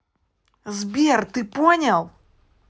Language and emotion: Russian, angry